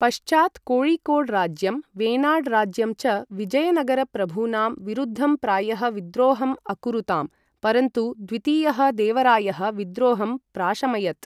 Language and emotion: Sanskrit, neutral